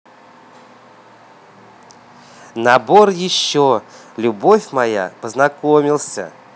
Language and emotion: Russian, positive